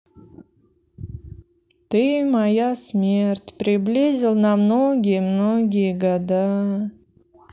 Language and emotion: Russian, sad